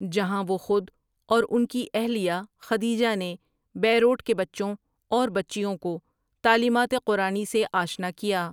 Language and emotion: Urdu, neutral